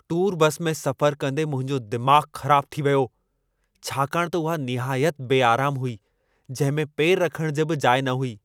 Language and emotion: Sindhi, angry